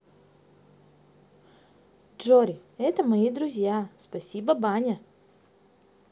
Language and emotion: Russian, positive